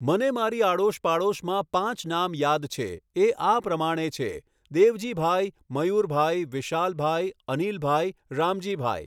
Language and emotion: Gujarati, neutral